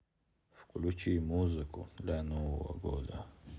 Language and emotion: Russian, neutral